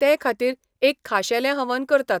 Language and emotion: Goan Konkani, neutral